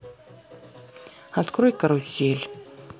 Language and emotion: Russian, neutral